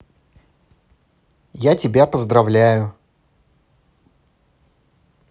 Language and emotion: Russian, positive